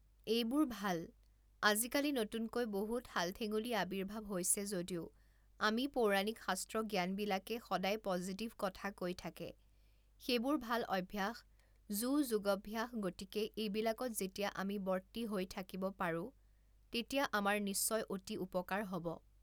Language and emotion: Assamese, neutral